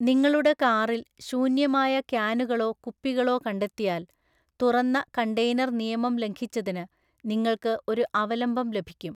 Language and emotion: Malayalam, neutral